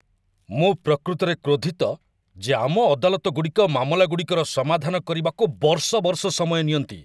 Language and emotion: Odia, angry